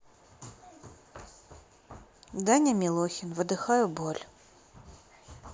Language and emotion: Russian, neutral